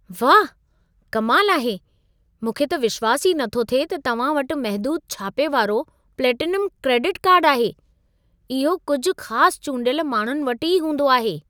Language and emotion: Sindhi, surprised